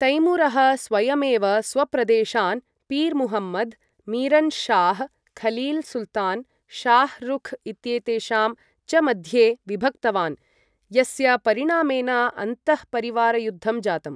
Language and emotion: Sanskrit, neutral